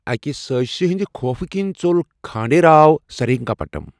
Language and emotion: Kashmiri, neutral